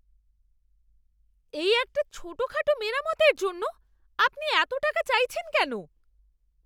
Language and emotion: Bengali, angry